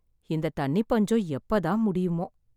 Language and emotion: Tamil, sad